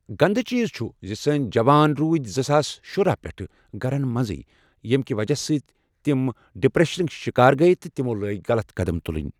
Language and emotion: Kashmiri, neutral